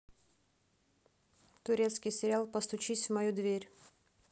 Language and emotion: Russian, neutral